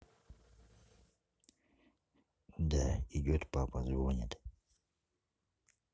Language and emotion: Russian, neutral